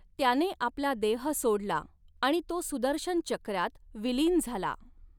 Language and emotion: Marathi, neutral